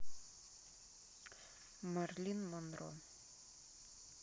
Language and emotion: Russian, neutral